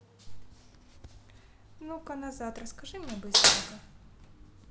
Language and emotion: Russian, neutral